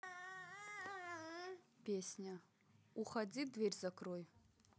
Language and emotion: Russian, neutral